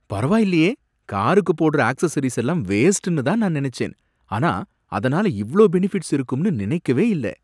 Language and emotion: Tamil, surprised